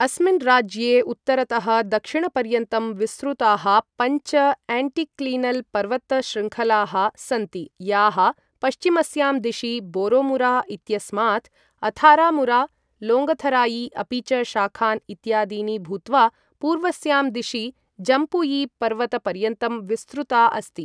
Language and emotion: Sanskrit, neutral